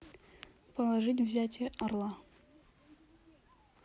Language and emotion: Russian, neutral